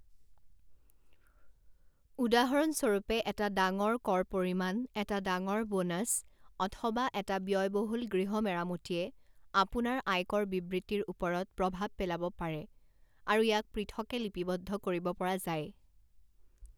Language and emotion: Assamese, neutral